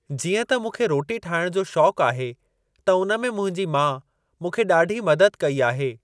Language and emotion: Sindhi, neutral